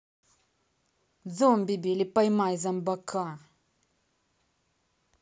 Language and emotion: Russian, angry